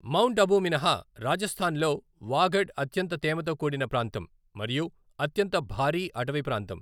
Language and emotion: Telugu, neutral